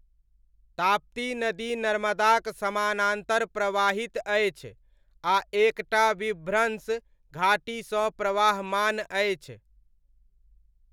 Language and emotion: Maithili, neutral